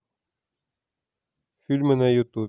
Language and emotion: Russian, neutral